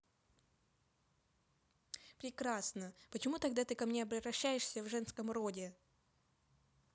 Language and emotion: Russian, angry